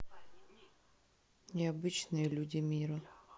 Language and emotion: Russian, neutral